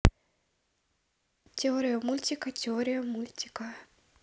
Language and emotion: Russian, neutral